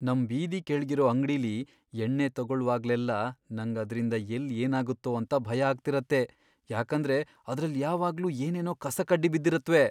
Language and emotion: Kannada, fearful